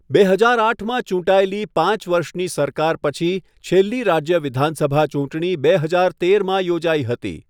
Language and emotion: Gujarati, neutral